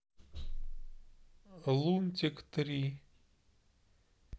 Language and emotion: Russian, neutral